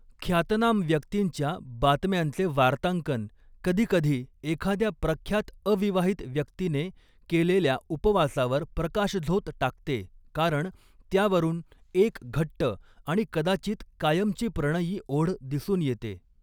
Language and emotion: Marathi, neutral